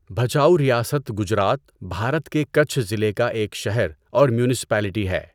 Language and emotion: Urdu, neutral